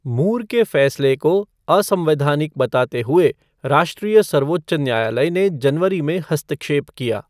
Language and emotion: Hindi, neutral